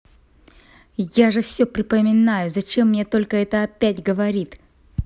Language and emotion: Russian, angry